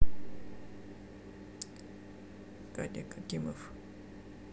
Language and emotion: Russian, neutral